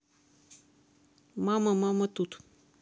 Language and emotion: Russian, neutral